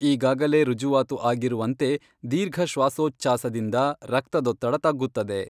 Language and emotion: Kannada, neutral